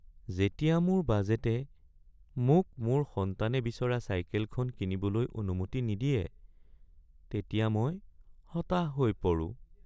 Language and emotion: Assamese, sad